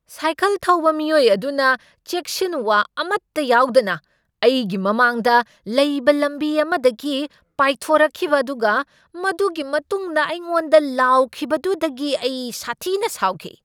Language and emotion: Manipuri, angry